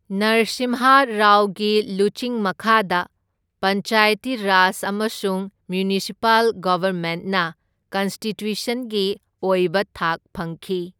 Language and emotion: Manipuri, neutral